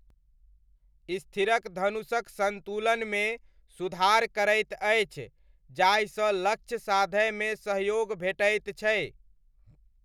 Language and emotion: Maithili, neutral